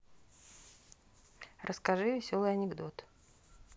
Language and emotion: Russian, neutral